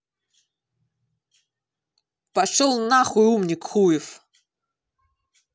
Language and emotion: Russian, angry